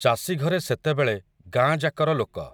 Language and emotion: Odia, neutral